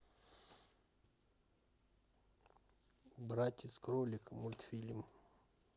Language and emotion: Russian, neutral